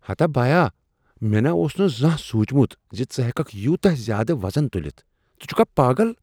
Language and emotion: Kashmiri, surprised